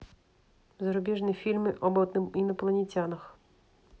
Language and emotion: Russian, neutral